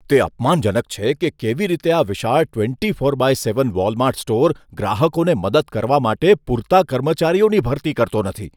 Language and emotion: Gujarati, disgusted